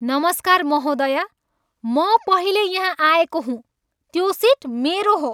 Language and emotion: Nepali, angry